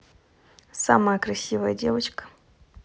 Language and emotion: Russian, positive